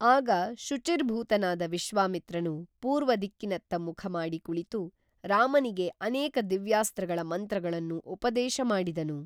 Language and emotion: Kannada, neutral